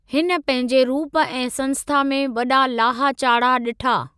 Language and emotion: Sindhi, neutral